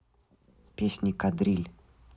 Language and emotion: Russian, neutral